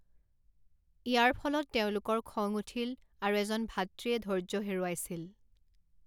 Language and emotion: Assamese, neutral